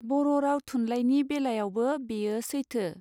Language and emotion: Bodo, neutral